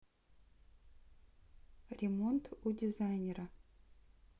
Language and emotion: Russian, neutral